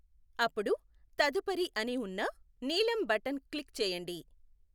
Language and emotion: Telugu, neutral